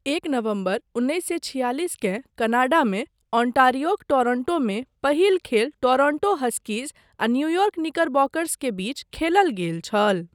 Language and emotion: Maithili, neutral